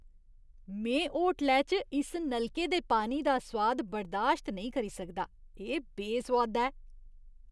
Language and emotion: Dogri, disgusted